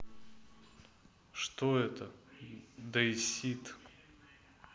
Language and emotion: Russian, neutral